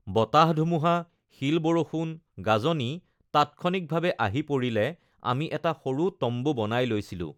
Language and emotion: Assamese, neutral